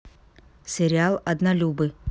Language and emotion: Russian, neutral